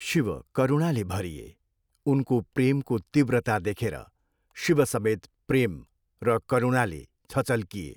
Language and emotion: Nepali, neutral